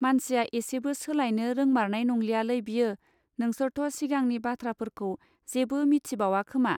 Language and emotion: Bodo, neutral